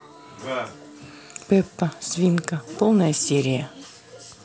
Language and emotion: Russian, neutral